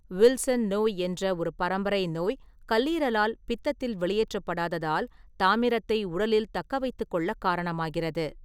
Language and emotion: Tamil, neutral